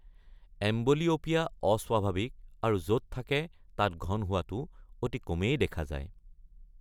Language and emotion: Assamese, neutral